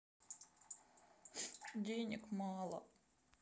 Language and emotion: Russian, sad